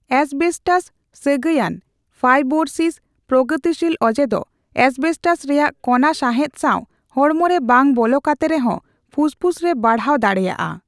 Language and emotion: Santali, neutral